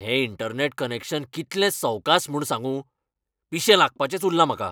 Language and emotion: Goan Konkani, angry